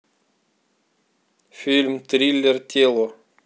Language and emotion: Russian, neutral